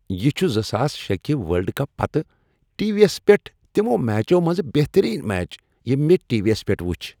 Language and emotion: Kashmiri, happy